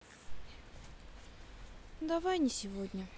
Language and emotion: Russian, neutral